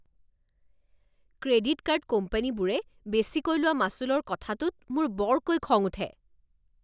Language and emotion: Assamese, angry